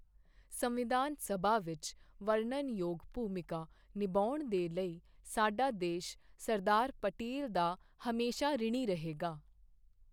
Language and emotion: Punjabi, neutral